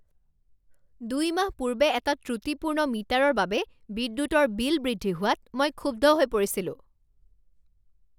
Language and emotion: Assamese, angry